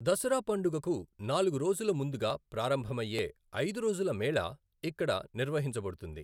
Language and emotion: Telugu, neutral